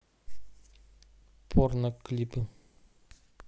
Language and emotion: Russian, neutral